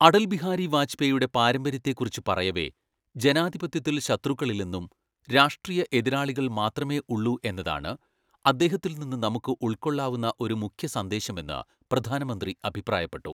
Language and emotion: Malayalam, neutral